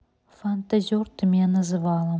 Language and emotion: Russian, neutral